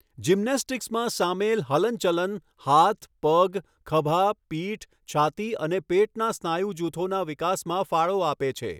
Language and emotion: Gujarati, neutral